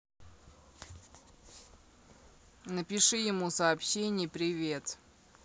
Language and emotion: Russian, neutral